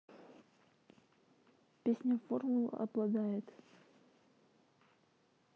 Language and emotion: Russian, neutral